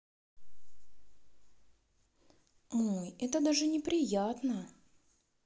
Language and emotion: Russian, sad